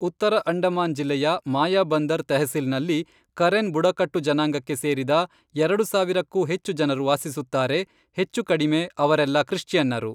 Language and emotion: Kannada, neutral